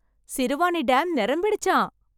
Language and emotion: Tamil, happy